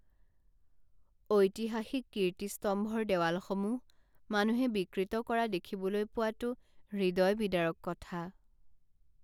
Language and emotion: Assamese, sad